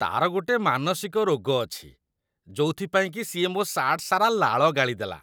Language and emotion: Odia, disgusted